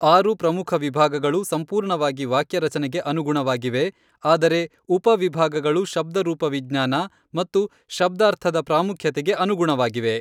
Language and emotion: Kannada, neutral